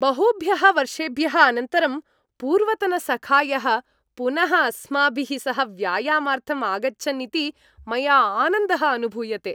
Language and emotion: Sanskrit, happy